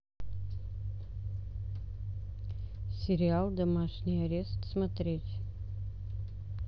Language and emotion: Russian, neutral